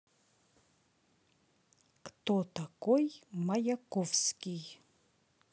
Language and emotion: Russian, neutral